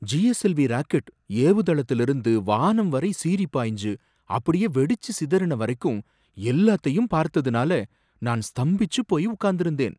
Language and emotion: Tamil, surprised